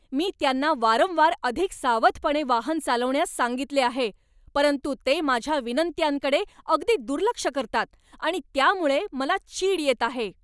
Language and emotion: Marathi, angry